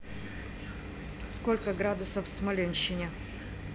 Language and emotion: Russian, neutral